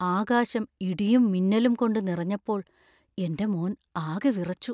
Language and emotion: Malayalam, fearful